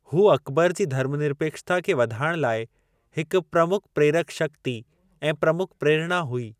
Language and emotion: Sindhi, neutral